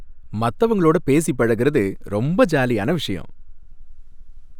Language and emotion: Tamil, happy